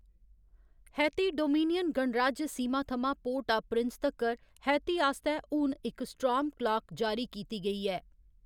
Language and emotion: Dogri, neutral